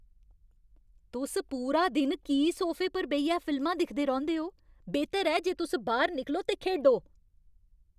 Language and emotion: Dogri, angry